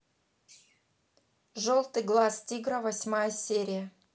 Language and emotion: Russian, neutral